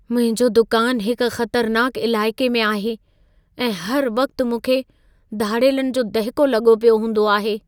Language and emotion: Sindhi, fearful